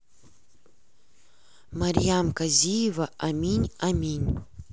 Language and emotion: Russian, neutral